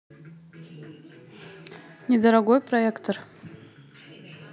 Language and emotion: Russian, neutral